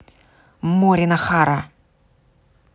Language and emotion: Russian, angry